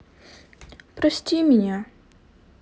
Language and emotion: Russian, sad